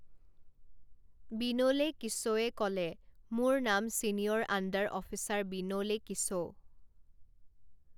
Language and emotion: Assamese, neutral